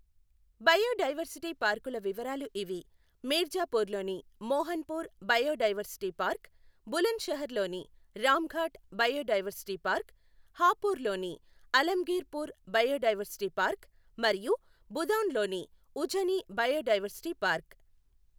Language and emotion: Telugu, neutral